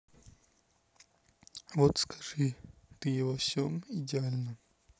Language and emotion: Russian, neutral